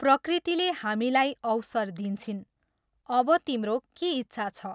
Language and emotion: Nepali, neutral